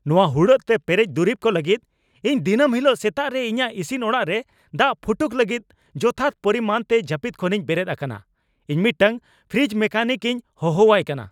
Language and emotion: Santali, angry